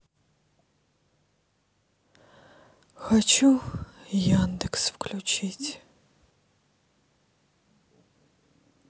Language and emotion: Russian, sad